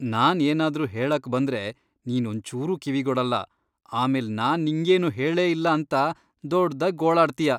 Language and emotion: Kannada, disgusted